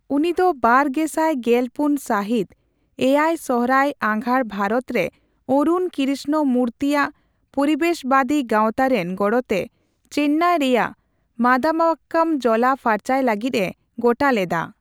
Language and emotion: Santali, neutral